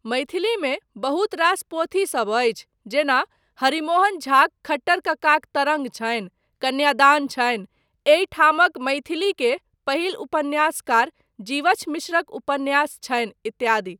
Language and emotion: Maithili, neutral